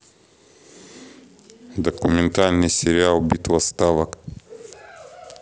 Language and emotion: Russian, neutral